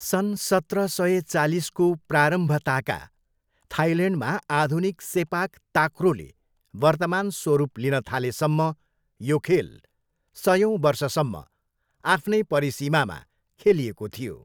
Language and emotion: Nepali, neutral